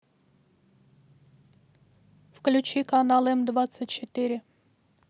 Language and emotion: Russian, neutral